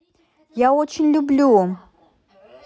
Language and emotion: Russian, positive